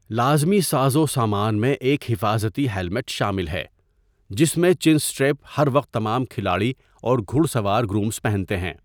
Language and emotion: Urdu, neutral